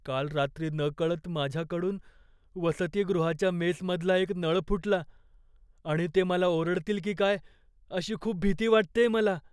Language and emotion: Marathi, fearful